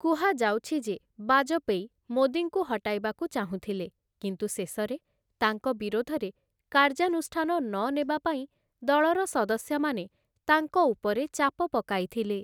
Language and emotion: Odia, neutral